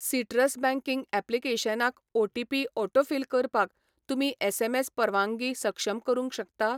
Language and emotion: Goan Konkani, neutral